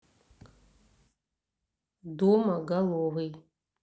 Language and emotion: Russian, neutral